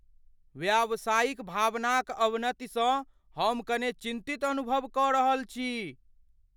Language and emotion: Maithili, fearful